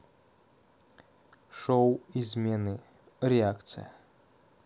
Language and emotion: Russian, neutral